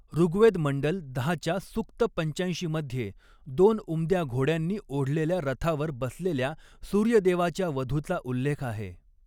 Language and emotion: Marathi, neutral